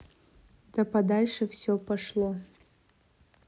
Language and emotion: Russian, neutral